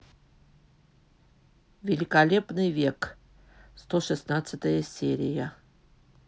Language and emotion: Russian, neutral